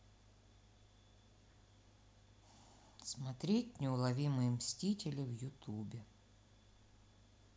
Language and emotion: Russian, sad